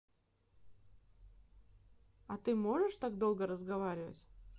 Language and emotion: Russian, neutral